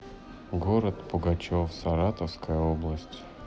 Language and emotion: Russian, neutral